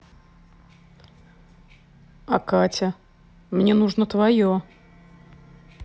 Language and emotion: Russian, neutral